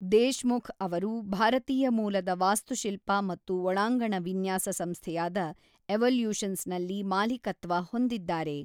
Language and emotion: Kannada, neutral